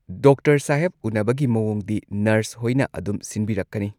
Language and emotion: Manipuri, neutral